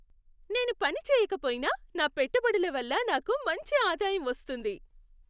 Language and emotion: Telugu, happy